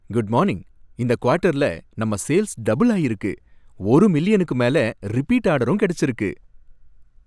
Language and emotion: Tamil, happy